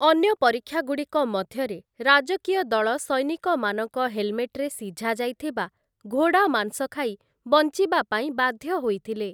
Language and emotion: Odia, neutral